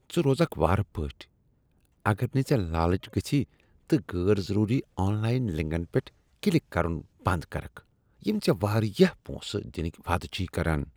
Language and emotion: Kashmiri, disgusted